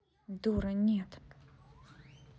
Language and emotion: Russian, angry